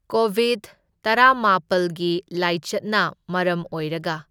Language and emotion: Manipuri, neutral